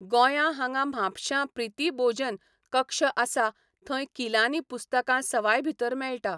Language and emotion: Goan Konkani, neutral